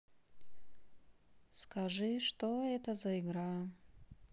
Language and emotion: Russian, sad